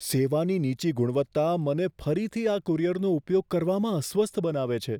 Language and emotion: Gujarati, fearful